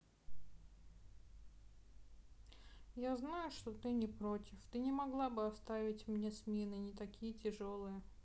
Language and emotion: Russian, sad